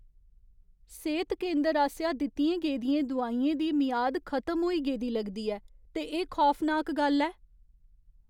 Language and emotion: Dogri, fearful